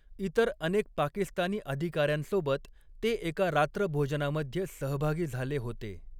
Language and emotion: Marathi, neutral